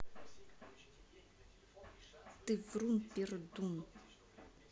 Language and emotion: Russian, angry